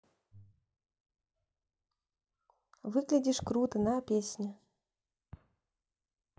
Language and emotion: Russian, neutral